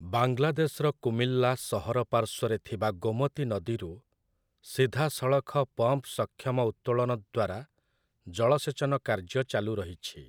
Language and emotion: Odia, neutral